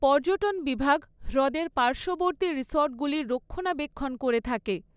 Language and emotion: Bengali, neutral